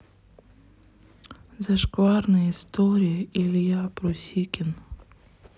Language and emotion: Russian, sad